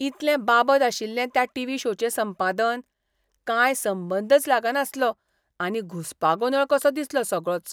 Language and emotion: Goan Konkani, disgusted